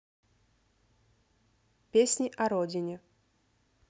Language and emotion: Russian, neutral